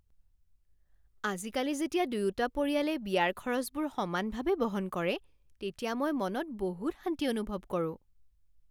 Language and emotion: Assamese, happy